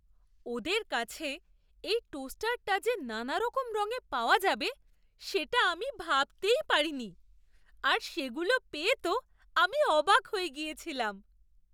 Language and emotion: Bengali, surprised